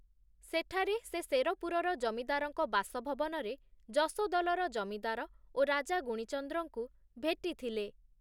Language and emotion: Odia, neutral